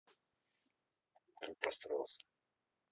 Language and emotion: Russian, neutral